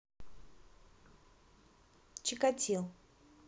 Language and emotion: Russian, neutral